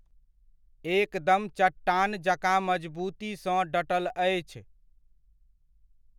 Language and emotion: Maithili, neutral